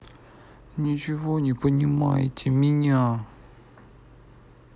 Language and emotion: Russian, sad